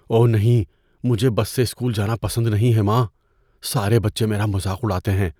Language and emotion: Urdu, fearful